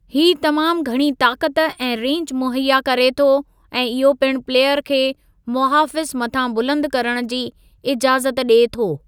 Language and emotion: Sindhi, neutral